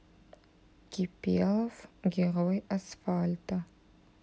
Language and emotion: Russian, neutral